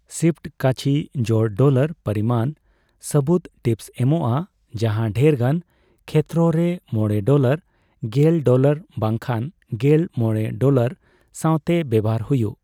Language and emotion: Santali, neutral